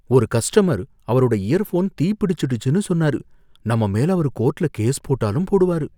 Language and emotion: Tamil, fearful